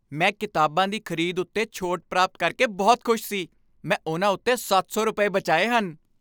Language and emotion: Punjabi, happy